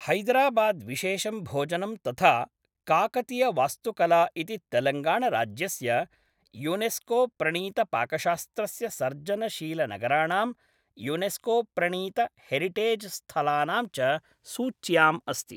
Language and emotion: Sanskrit, neutral